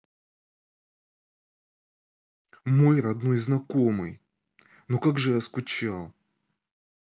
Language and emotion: Russian, angry